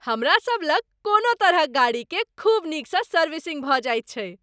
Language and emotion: Maithili, happy